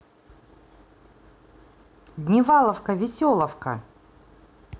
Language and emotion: Russian, positive